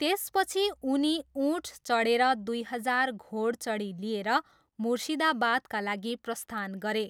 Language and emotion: Nepali, neutral